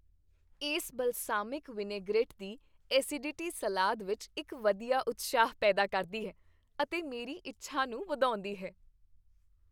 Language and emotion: Punjabi, happy